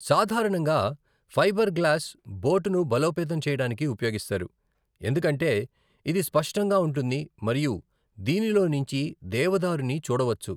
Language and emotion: Telugu, neutral